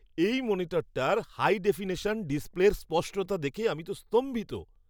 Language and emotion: Bengali, surprised